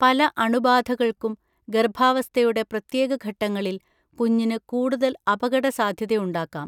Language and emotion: Malayalam, neutral